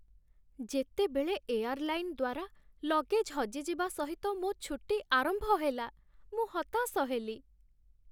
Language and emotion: Odia, sad